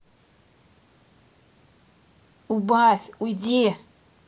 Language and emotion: Russian, angry